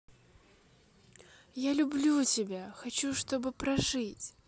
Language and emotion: Russian, positive